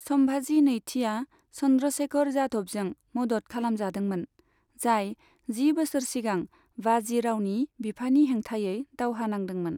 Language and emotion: Bodo, neutral